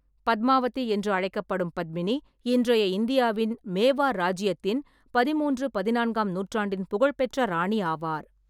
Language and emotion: Tamil, neutral